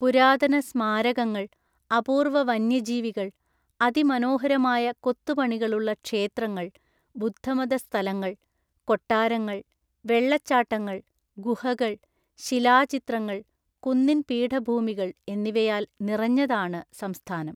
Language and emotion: Malayalam, neutral